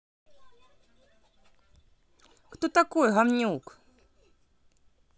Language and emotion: Russian, angry